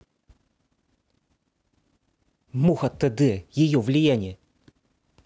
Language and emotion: Russian, neutral